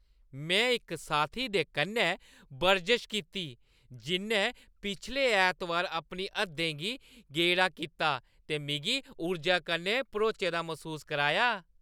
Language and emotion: Dogri, happy